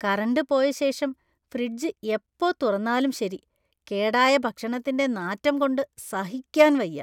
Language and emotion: Malayalam, disgusted